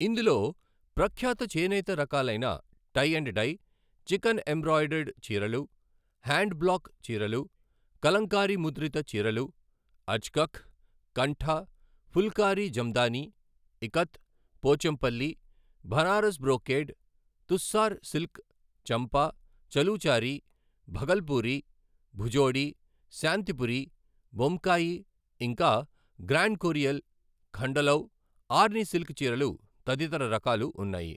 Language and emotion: Telugu, neutral